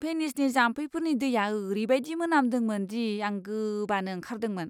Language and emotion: Bodo, disgusted